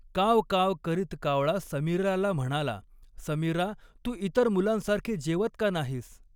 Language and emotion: Marathi, neutral